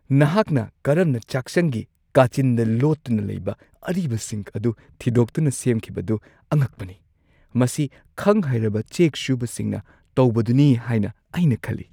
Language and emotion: Manipuri, surprised